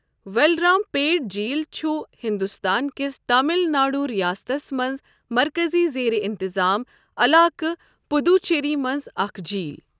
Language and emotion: Kashmiri, neutral